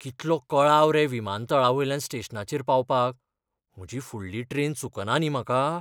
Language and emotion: Goan Konkani, fearful